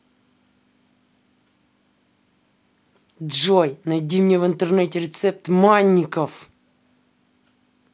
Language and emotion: Russian, angry